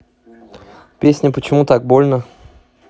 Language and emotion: Russian, neutral